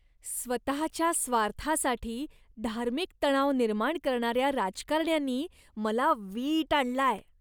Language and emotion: Marathi, disgusted